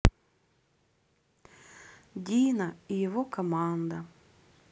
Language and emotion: Russian, neutral